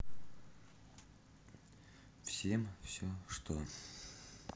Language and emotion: Russian, sad